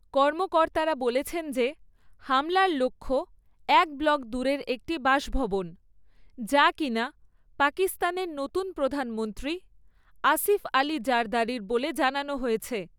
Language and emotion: Bengali, neutral